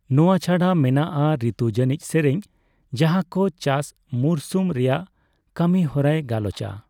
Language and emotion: Santali, neutral